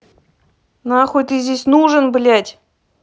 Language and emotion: Russian, angry